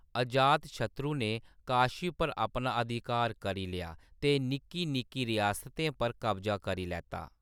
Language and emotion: Dogri, neutral